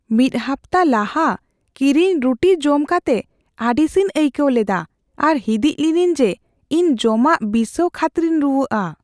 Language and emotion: Santali, fearful